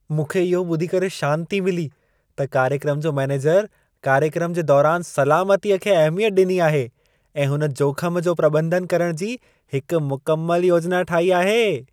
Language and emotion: Sindhi, happy